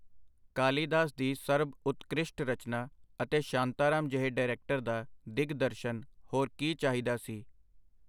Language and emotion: Punjabi, neutral